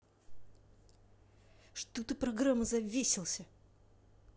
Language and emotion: Russian, angry